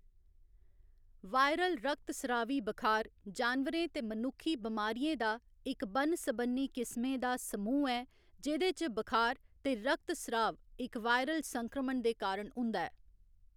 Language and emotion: Dogri, neutral